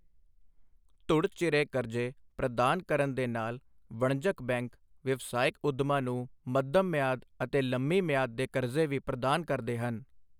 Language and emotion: Punjabi, neutral